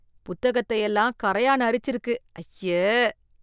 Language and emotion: Tamil, disgusted